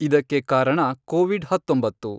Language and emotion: Kannada, neutral